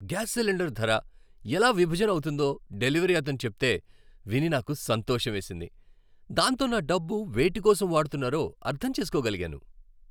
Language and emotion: Telugu, happy